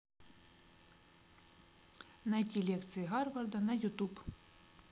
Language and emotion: Russian, neutral